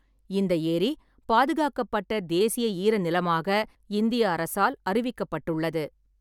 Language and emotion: Tamil, neutral